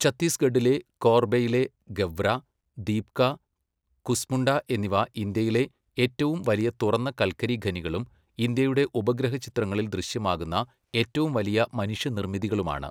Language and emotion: Malayalam, neutral